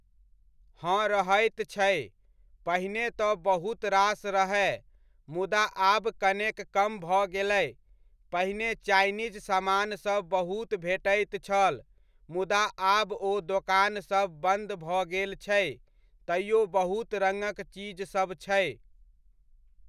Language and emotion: Maithili, neutral